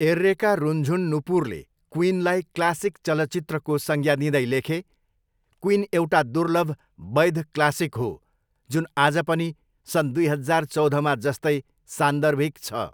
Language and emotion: Nepali, neutral